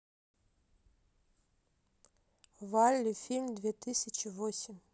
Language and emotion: Russian, neutral